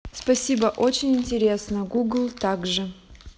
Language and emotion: Russian, neutral